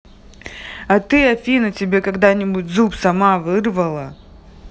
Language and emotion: Russian, angry